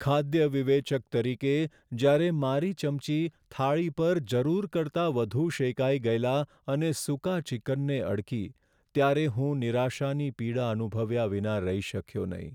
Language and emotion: Gujarati, sad